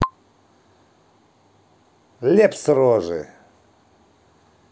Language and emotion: Russian, angry